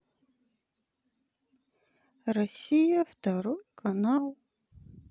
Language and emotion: Russian, sad